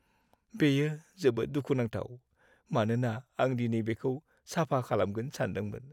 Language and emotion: Bodo, sad